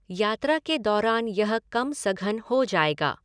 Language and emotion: Hindi, neutral